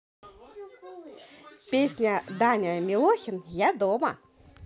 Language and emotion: Russian, positive